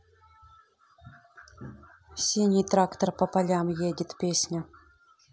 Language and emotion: Russian, neutral